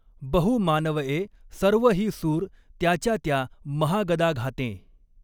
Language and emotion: Marathi, neutral